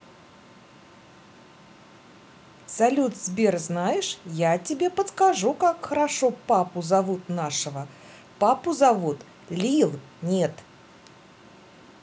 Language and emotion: Russian, positive